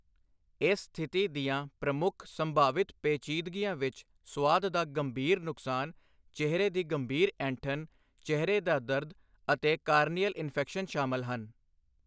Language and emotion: Punjabi, neutral